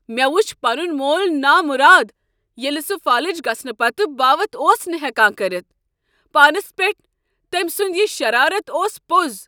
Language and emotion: Kashmiri, angry